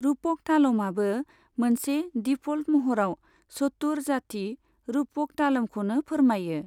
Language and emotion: Bodo, neutral